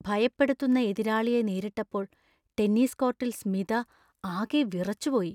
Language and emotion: Malayalam, fearful